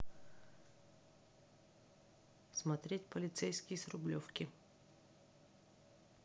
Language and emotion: Russian, neutral